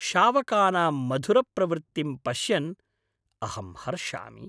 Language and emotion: Sanskrit, happy